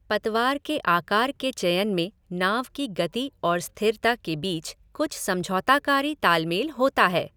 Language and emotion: Hindi, neutral